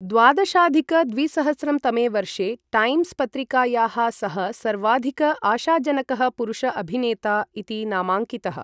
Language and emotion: Sanskrit, neutral